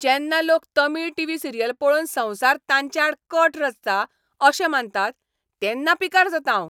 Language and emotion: Goan Konkani, angry